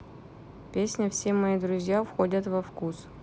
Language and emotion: Russian, neutral